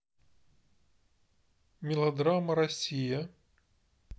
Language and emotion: Russian, neutral